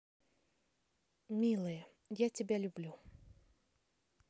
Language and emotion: Russian, positive